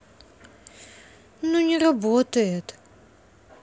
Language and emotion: Russian, sad